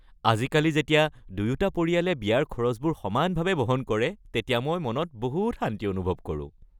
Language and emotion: Assamese, happy